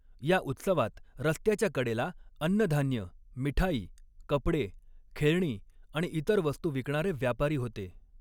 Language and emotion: Marathi, neutral